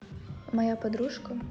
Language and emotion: Russian, neutral